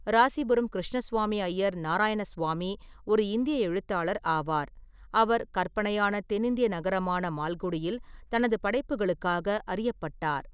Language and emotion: Tamil, neutral